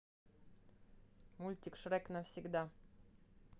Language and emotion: Russian, neutral